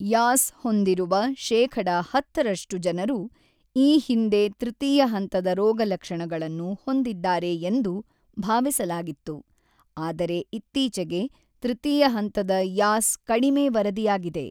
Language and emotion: Kannada, neutral